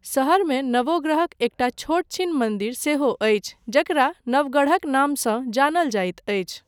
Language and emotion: Maithili, neutral